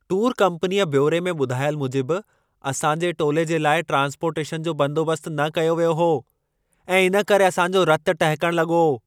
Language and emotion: Sindhi, angry